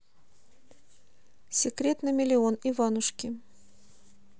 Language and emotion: Russian, neutral